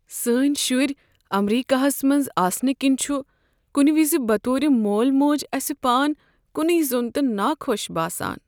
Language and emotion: Kashmiri, sad